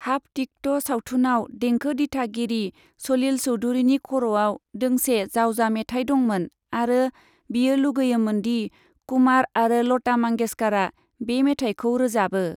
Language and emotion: Bodo, neutral